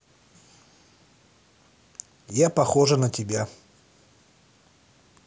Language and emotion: Russian, neutral